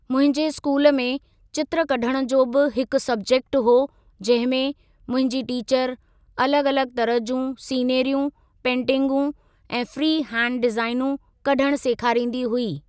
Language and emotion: Sindhi, neutral